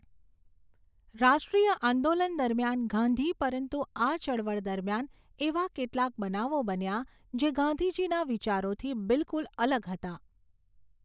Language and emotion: Gujarati, neutral